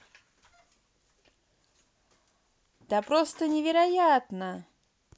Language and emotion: Russian, positive